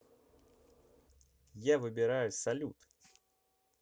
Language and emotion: Russian, positive